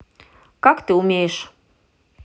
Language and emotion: Russian, neutral